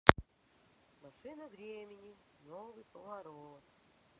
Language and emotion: Russian, neutral